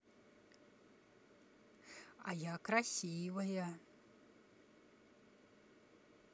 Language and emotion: Russian, neutral